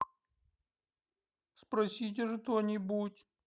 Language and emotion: Russian, sad